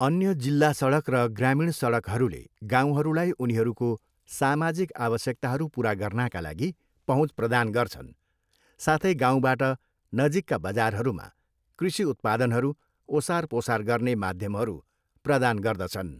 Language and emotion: Nepali, neutral